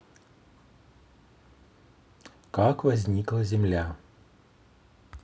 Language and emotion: Russian, neutral